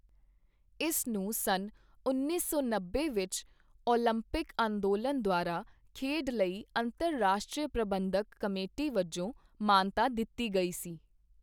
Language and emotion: Punjabi, neutral